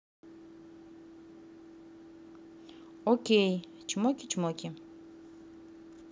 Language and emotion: Russian, neutral